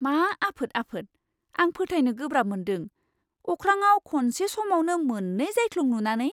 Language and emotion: Bodo, surprised